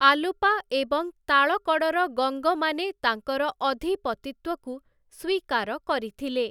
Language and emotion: Odia, neutral